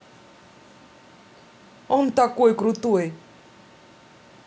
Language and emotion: Russian, positive